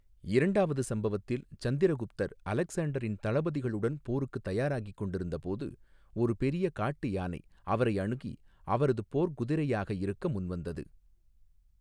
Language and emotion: Tamil, neutral